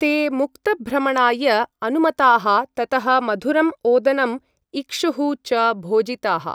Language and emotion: Sanskrit, neutral